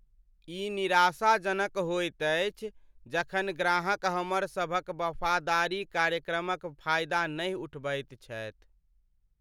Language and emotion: Maithili, sad